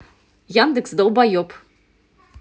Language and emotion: Russian, angry